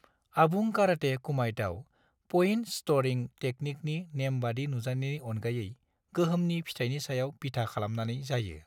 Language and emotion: Bodo, neutral